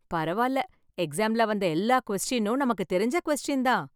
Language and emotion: Tamil, happy